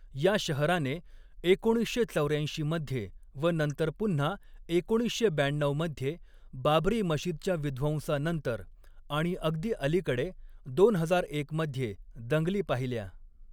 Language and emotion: Marathi, neutral